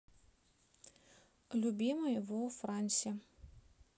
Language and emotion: Russian, neutral